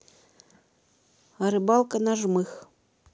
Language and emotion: Russian, neutral